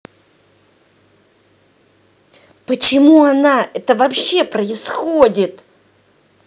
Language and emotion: Russian, angry